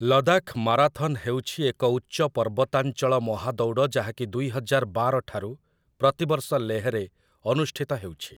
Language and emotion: Odia, neutral